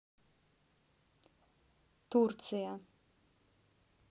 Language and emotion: Russian, neutral